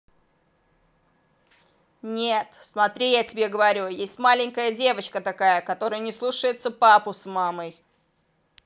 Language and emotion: Russian, angry